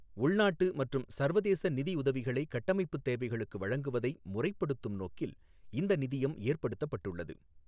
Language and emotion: Tamil, neutral